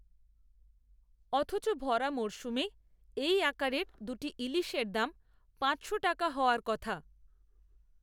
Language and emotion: Bengali, neutral